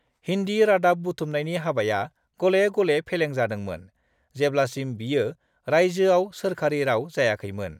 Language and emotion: Bodo, neutral